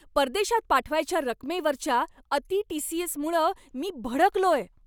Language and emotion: Marathi, angry